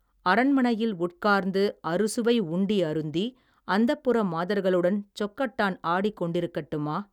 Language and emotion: Tamil, neutral